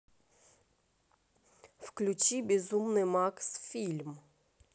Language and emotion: Russian, neutral